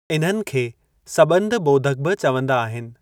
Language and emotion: Sindhi, neutral